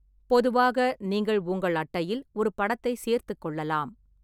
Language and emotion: Tamil, neutral